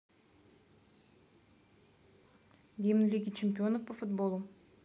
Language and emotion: Russian, neutral